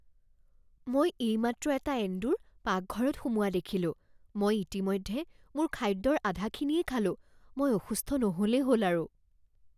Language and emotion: Assamese, fearful